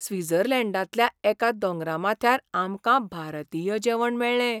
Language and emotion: Goan Konkani, surprised